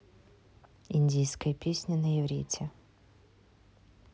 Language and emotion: Russian, neutral